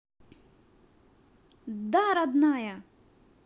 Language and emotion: Russian, positive